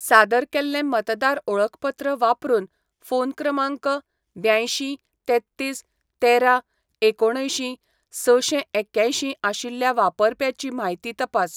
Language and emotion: Goan Konkani, neutral